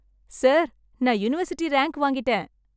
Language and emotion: Tamil, happy